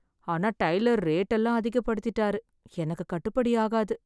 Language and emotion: Tamil, sad